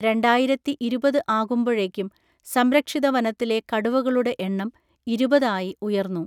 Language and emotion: Malayalam, neutral